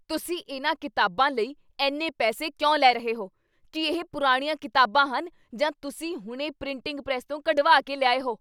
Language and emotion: Punjabi, angry